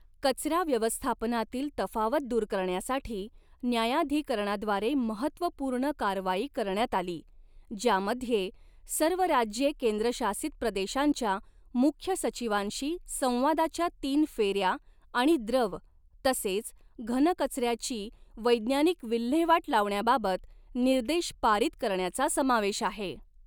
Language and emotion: Marathi, neutral